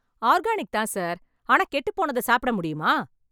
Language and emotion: Tamil, angry